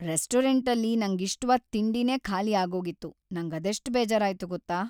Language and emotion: Kannada, sad